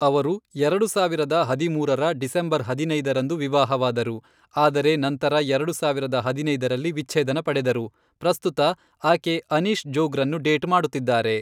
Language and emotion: Kannada, neutral